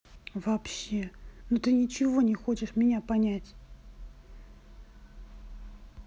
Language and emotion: Russian, neutral